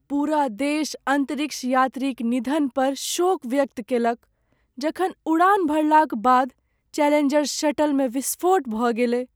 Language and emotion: Maithili, sad